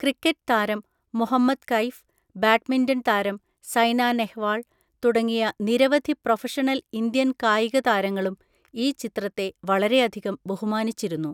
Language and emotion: Malayalam, neutral